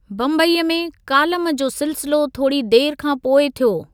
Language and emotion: Sindhi, neutral